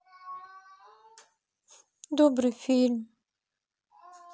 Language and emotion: Russian, sad